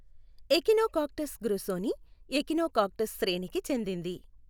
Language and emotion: Telugu, neutral